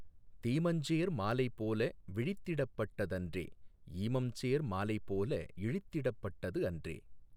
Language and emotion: Tamil, neutral